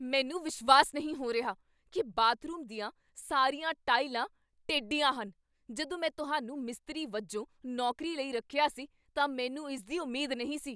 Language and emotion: Punjabi, angry